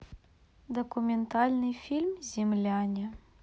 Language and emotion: Russian, neutral